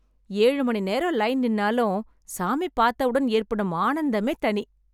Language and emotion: Tamil, happy